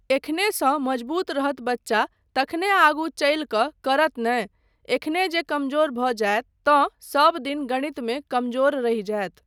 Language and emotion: Maithili, neutral